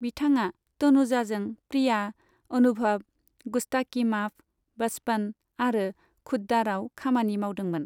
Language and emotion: Bodo, neutral